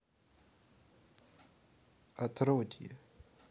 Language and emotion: Russian, neutral